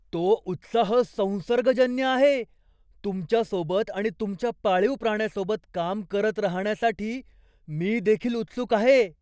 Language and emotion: Marathi, surprised